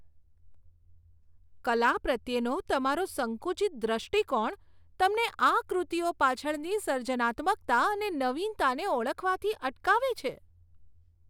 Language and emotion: Gujarati, disgusted